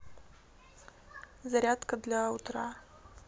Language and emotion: Russian, neutral